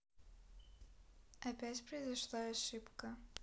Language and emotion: Russian, neutral